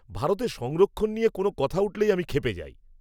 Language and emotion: Bengali, angry